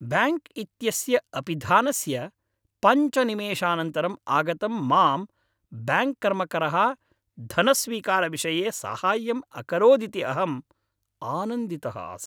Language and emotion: Sanskrit, happy